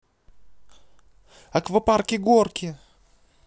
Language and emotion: Russian, positive